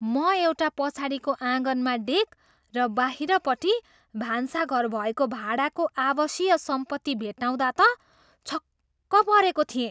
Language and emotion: Nepali, surprised